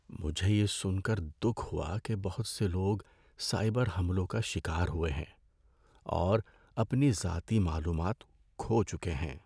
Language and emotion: Urdu, sad